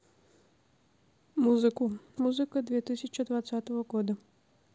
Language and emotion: Russian, neutral